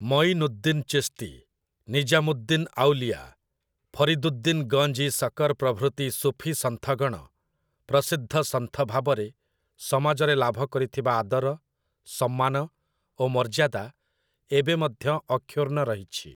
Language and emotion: Odia, neutral